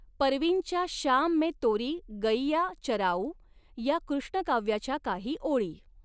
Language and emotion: Marathi, neutral